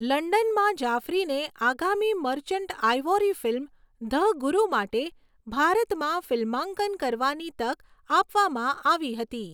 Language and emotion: Gujarati, neutral